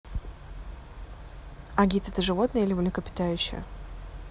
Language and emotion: Russian, neutral